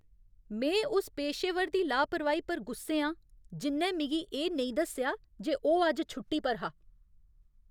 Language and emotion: Dogri, angry